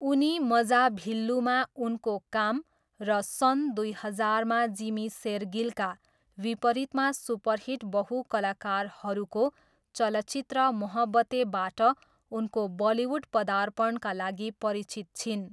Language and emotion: Nepali, neutral